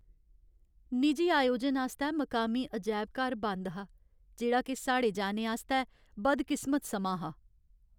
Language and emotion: Dogri, sad